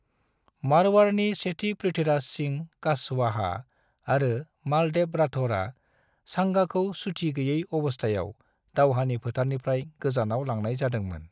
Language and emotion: Bodo, neutral